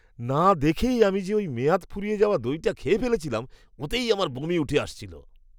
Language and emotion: Bengali, disgusted